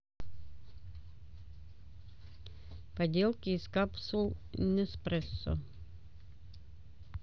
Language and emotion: Russian, neutral